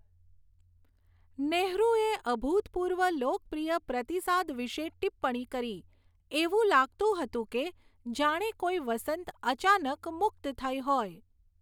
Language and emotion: Gujarati, neutral